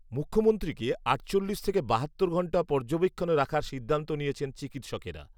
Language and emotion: Bengali, neutral